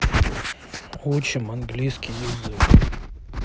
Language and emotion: Russian, neutral